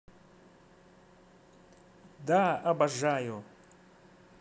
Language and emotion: Russian, positive